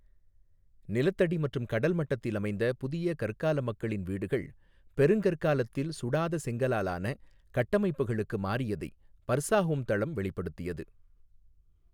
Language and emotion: Tamil, neutral